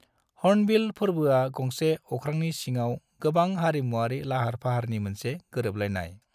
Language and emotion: Bodo, neutral